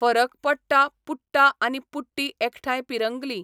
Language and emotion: Goan Konkani, neutral